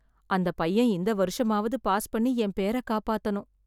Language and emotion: Tamil, sad